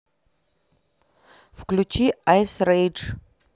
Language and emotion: Russian, neutral